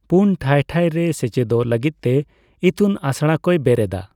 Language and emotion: Santali, neutral